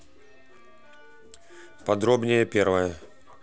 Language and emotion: Russian, neutral